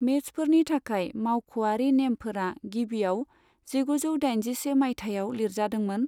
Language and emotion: Bodo, neutral